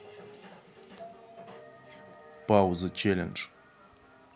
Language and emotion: Russian, neutral